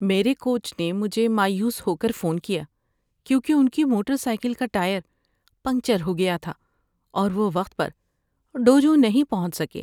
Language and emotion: Urdu, sad